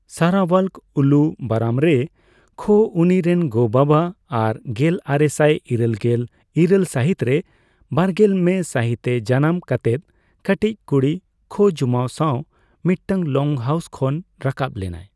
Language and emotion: Santali, neutral